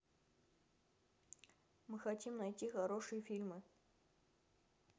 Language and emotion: Russian, neutral